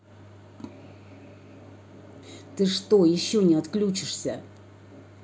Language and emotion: Russian, angry